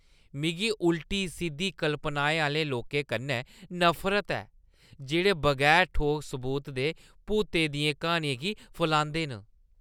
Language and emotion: Dogri, disgusted